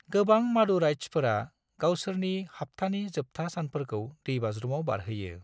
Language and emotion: Bodo, neutral